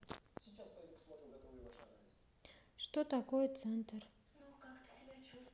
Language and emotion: Russian, neutral